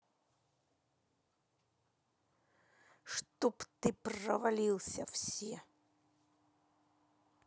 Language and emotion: Russian, angry